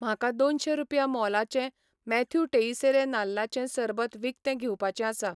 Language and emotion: Goan Konkani, neutral